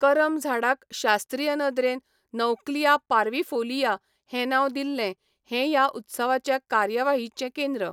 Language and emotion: Goan Konkani, neutral